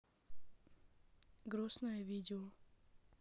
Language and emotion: Russian, neutral